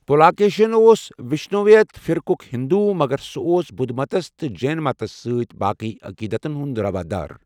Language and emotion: Kashmiri, neutral